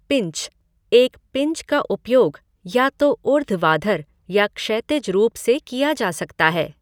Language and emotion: Hindi, neutral